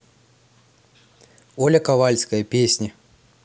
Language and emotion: Russian, neutral